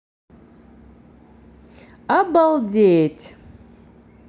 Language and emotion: Russian, positive